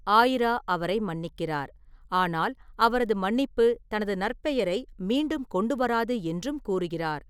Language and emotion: Tamil, neutral